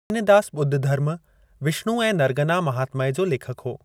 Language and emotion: Sindhi, neutral